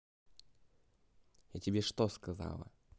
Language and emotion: Russian, angry